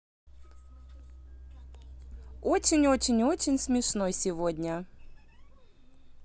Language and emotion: Russian, positive